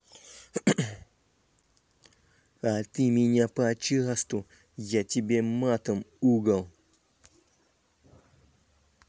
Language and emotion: Russian, angry